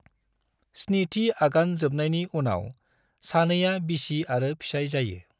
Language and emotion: Bodo, neutral